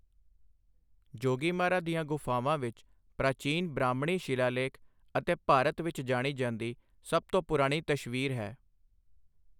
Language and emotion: Punjabi, neutral